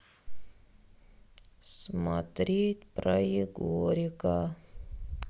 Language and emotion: Russian, sad